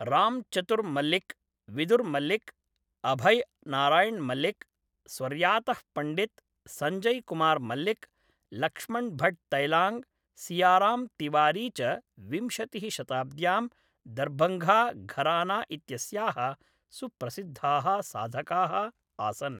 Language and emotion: Sanskrit, neutral